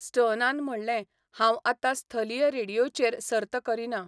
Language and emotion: Goan Konkani, neutral